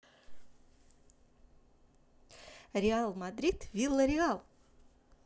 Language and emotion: Russian, positive